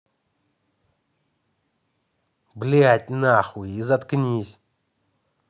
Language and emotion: Russian, angry